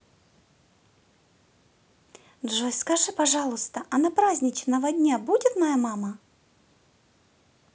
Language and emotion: Russian, positive